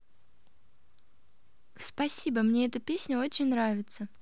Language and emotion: Russian, positive